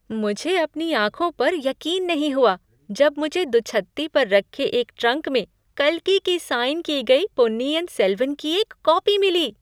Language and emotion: Hindi, surprised